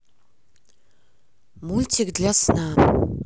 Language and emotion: Russian, neutral